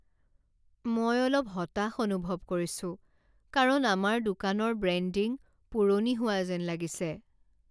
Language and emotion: Assamese, sad